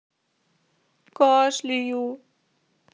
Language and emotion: Russian, sad